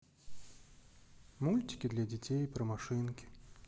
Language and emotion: Russian, sad